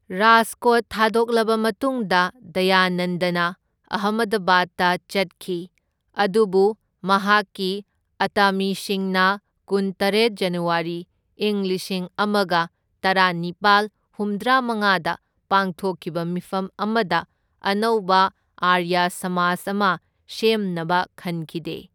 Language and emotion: Manipuri, neutral